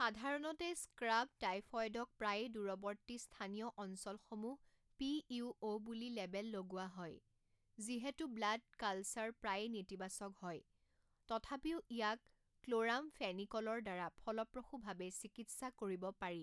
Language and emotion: Assamese, neutral